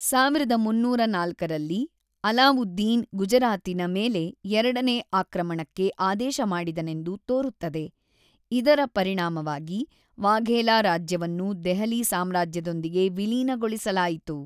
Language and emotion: Kannada, neutral